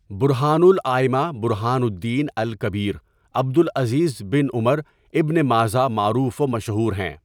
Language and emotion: Urdu, neutral